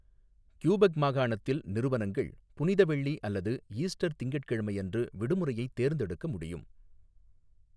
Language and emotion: Tamil, neutral